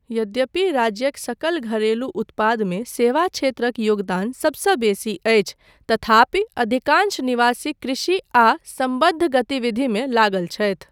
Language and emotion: Maithili, neutral